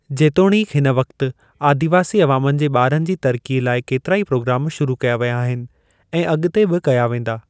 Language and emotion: Sindhi, neutral